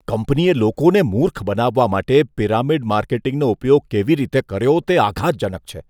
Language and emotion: Gujarati, disgusted